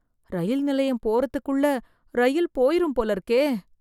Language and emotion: Tamil, fearful